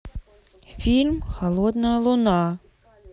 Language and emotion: Russian, neutral